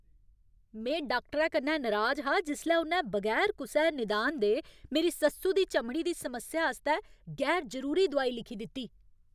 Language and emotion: Dogri, angry